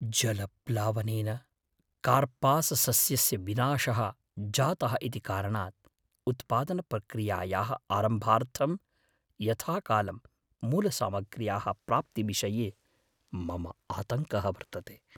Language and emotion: Sanskrit, fearful